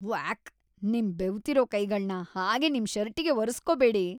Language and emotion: Kannada, disgusted